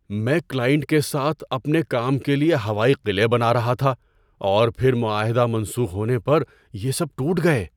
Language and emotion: Urdu, surprised